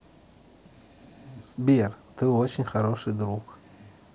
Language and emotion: Russian, neutral